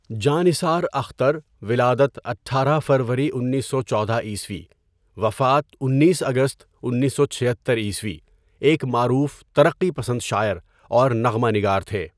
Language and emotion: Urdu, neutral